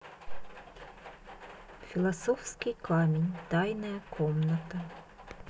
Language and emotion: Russian, neutral